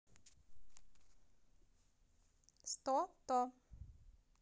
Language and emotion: Russian, positive